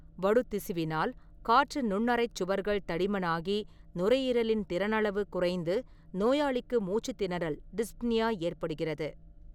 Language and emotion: Tamil, neutral